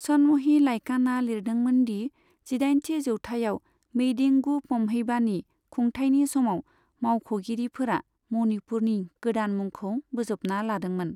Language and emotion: Bodo, neutral